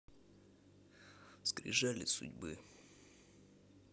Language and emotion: Russian, neutral